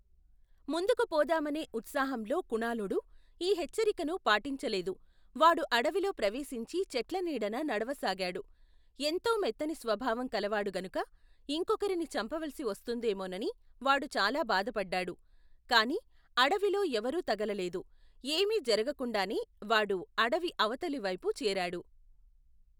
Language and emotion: Telugu, neutral